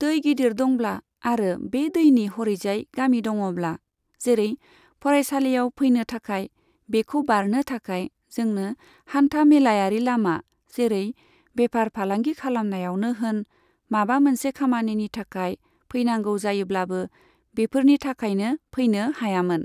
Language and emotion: Bodo, neutral